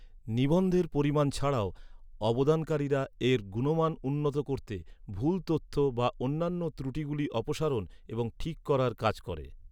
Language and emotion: Bengali, neutral